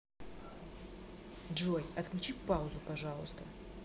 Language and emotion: Russian, neutral